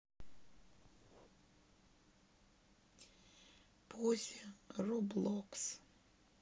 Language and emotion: Russian, sad